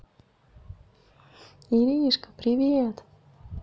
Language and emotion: Russian, positive